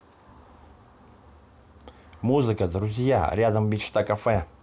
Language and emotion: Russian, positive